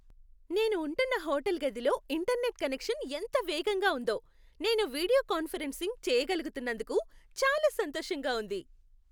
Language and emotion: Telugu, happy